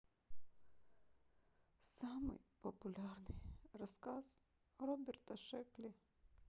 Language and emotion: Russian, sad